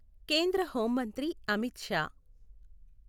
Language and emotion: Telugu, neutral